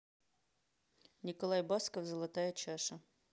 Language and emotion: Russian, neutral